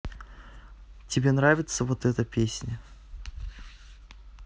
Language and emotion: Russian, neutral